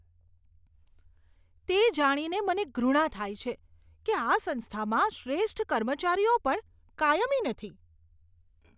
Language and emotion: Gujarati, disgusted